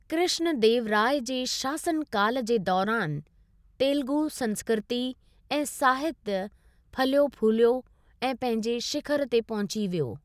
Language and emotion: Sindhi, neutral